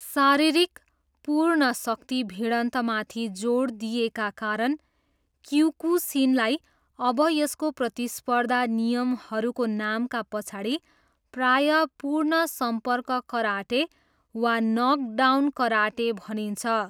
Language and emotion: Nepali, neutral